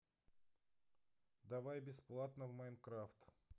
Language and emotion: Russian, neutral